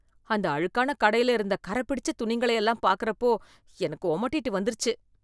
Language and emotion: Tamil, disgusted